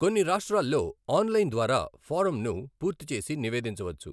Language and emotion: Telugu, neutral